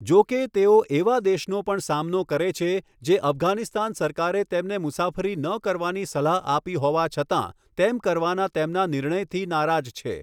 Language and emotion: Gujarati, neutral